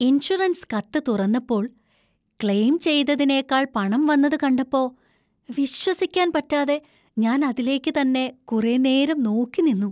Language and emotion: Malayalam, surprised